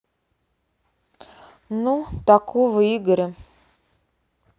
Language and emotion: Russian, neutral